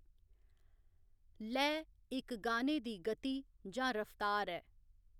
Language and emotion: Dogri, neutral